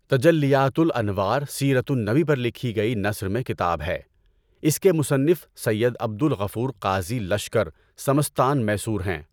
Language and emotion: Urdu, neutral